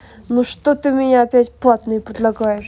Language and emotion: Russian, angry